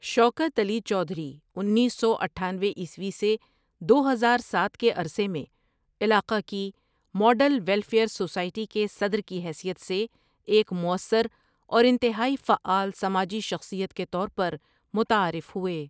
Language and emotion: Urdu, neutral